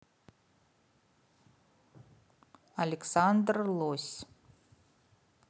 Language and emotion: Russian, neutral